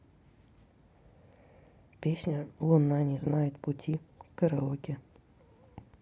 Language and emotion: Russian, neutral